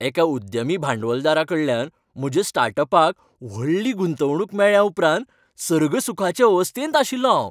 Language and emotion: Goan Konkani, happy